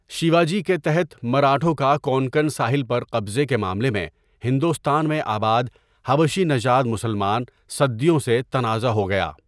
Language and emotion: Urdu, neutral